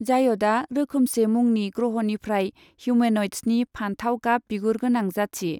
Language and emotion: Bodo, neutral